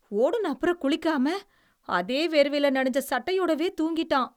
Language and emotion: Tamil, disgusted